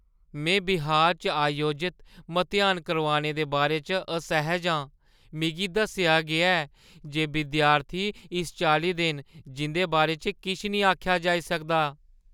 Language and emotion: Dogri, fearful